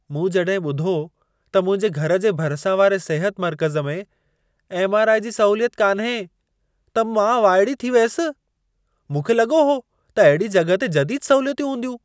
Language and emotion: Sindhi, surprised